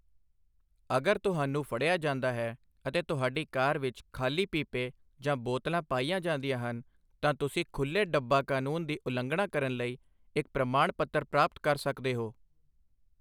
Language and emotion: Punjabi, neutral